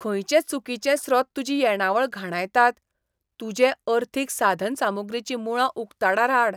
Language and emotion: Goan Konkani, disgusted